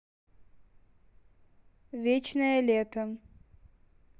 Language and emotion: Russian, neutral